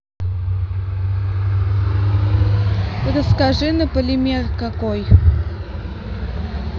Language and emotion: Russian, neutral